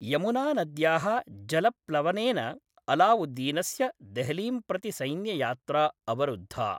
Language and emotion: Sanskrit, neutral